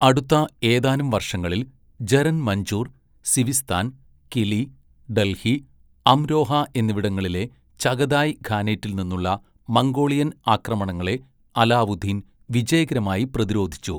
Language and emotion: Malayalam, neutral